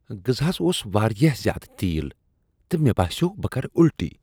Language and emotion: Kashmiri, disgusted